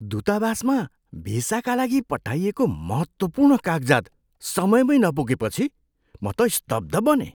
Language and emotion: Nepali, surprised